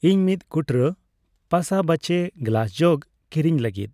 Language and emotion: Santali, neutral